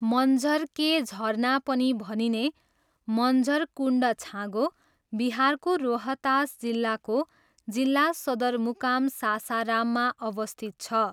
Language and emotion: Nepali, neutral